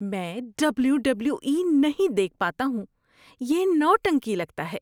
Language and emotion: Urdu, disgusted